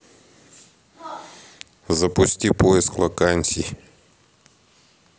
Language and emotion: Russian, neutral